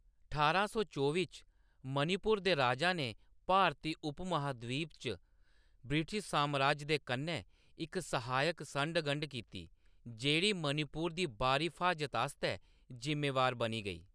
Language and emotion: Dogri, neutral